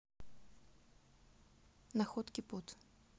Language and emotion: Russian, neutral